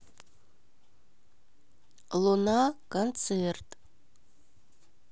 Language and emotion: Russian, neutral